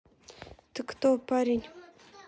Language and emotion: Russian, neutral